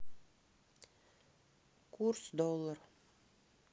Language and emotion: Russian, neutral